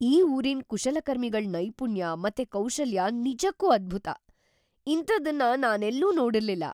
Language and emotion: Kannada, surprised